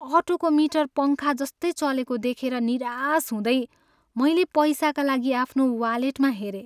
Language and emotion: Nepali, sad